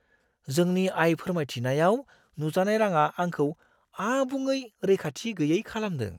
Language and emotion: Bodo, surprised